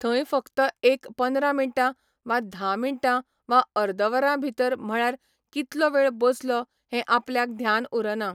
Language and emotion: Goan Konkani, neutral